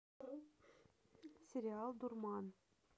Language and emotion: Russian, neutral